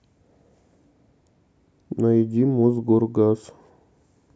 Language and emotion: Russian, neutral